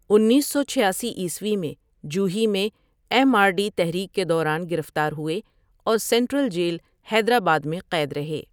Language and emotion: Urdu, neutral